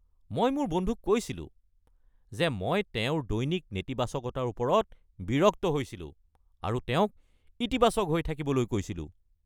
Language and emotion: Assamese, angry